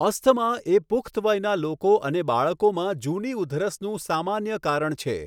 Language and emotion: Gujarati, neutral